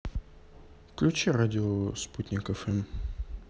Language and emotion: Russian, neutral